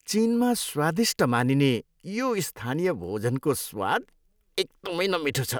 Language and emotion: Nepali, disgusted